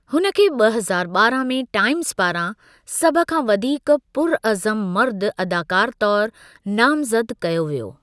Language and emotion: Sindhi, neutral